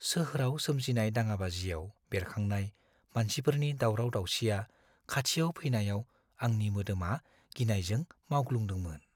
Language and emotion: Bodo, fearful